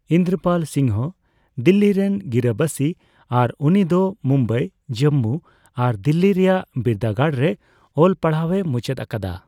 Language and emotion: Santali, neutral